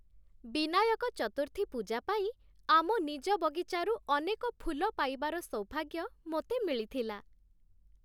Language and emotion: Odia, happy